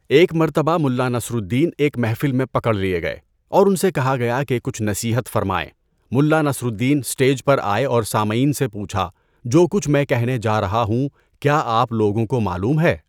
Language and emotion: Urdu, neutral